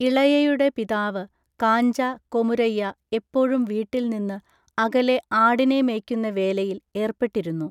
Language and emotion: Malayalam, neutral